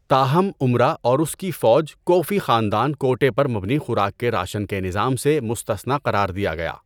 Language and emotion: Urdu, neutral